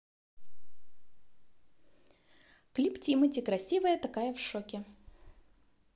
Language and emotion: Russian, positive